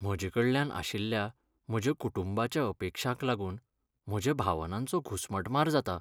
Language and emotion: Goan Konkani, sad